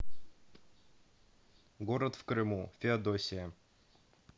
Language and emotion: Russian, neutral